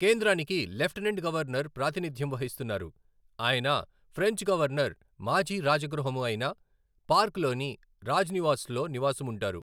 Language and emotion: Telugu, neutral